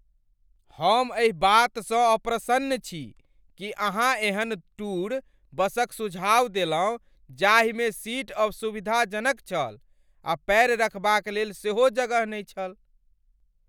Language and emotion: Maithili, angry